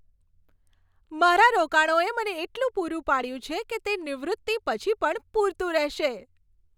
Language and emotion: Gujarati, happy